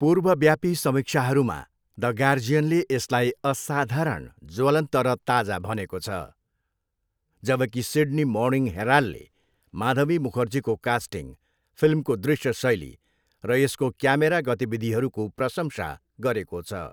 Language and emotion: Nepali, neutral